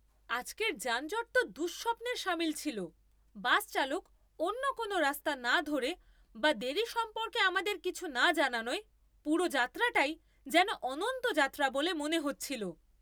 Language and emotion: Bengali, angry